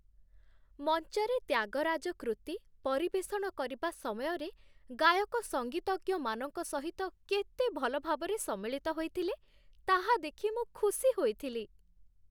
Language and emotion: Odia, happy